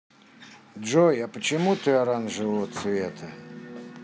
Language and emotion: Russian, neutral